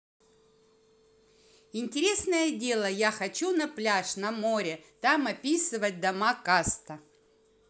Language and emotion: Russian, positive